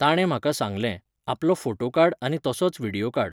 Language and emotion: Goan Konkani, neutral